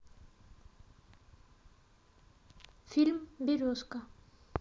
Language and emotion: Russian, neutral